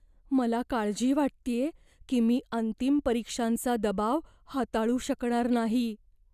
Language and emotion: Marathi, fearful